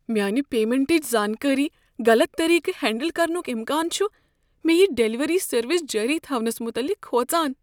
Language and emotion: Kashmiri, fearful